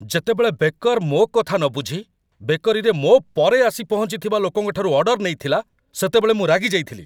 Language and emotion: Odia, angry